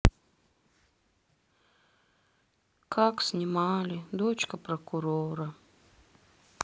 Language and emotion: Russian, sad